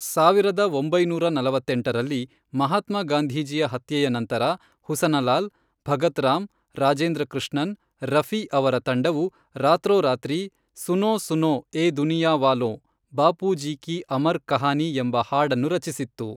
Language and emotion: Kannada, neutral